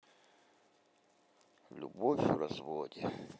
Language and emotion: Russian, sad